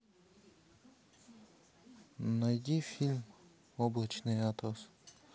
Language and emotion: Russian, neutral